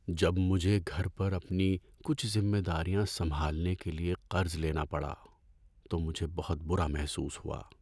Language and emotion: Urdu, sad